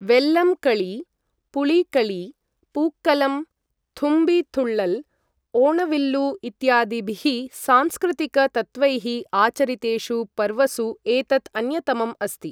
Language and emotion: Sanskrit, neutral